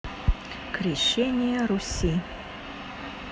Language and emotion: Russian, neutral